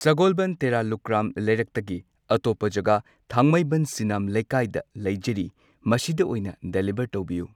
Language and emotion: Manipuri, neutral